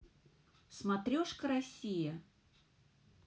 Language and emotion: Russian, neutral